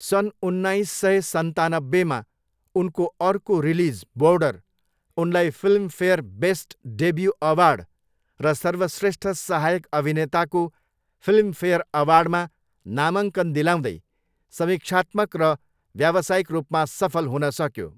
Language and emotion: Nepali, neutral